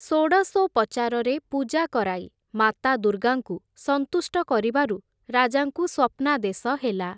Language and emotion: Odia, neutral